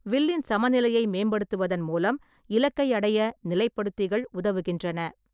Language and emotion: Tamil, neutral